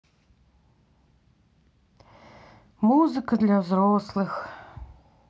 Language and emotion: Russian, sad